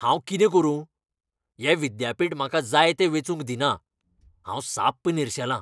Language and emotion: Goan Konkani, angry